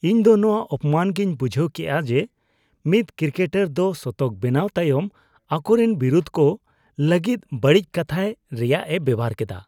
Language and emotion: Santali, disgusted